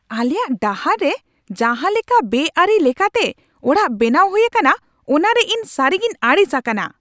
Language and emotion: Santali, angry